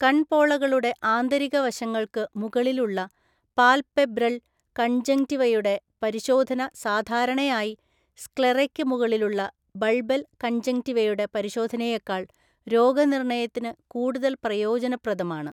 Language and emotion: Malayalam, neutral